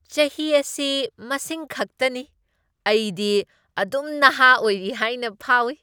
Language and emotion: Manipuri, happy